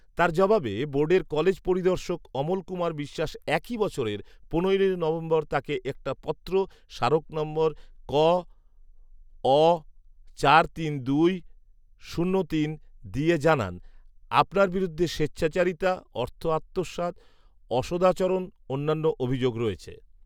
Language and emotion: Bengali, neutral